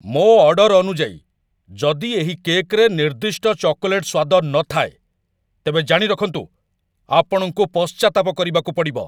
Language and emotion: Odia, angry